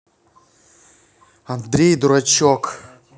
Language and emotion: Russian, angry